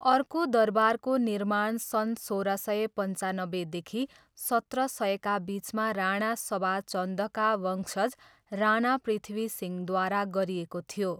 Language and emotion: Nepali, neutral